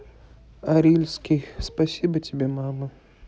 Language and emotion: Russian, sad